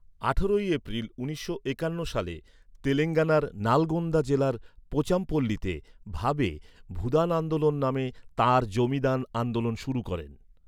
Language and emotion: Bengali, neutral